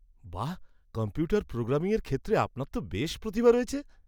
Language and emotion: Bengali, surprised